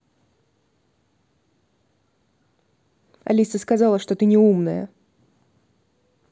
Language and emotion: Russian, angry